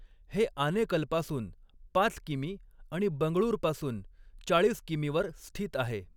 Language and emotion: Marathi, neutral